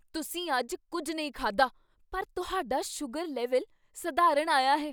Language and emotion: Punjabi, surprised